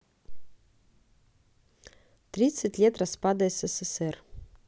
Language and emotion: Russian, neutral